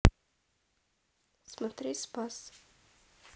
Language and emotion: Russian, neutral